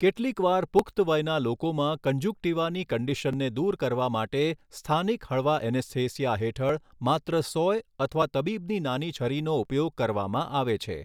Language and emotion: Gujarati, neutral